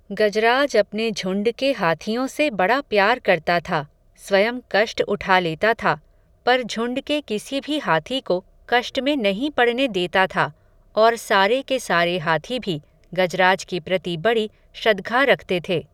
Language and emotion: Hindi, neutral